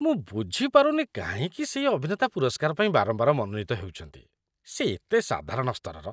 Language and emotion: Odia, disgusted